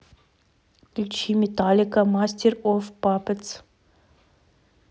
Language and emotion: Russian, neutral